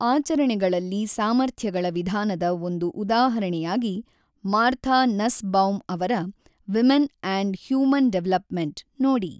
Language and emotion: Kannada, neutral